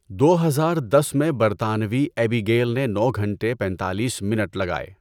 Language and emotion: Urdu, neutral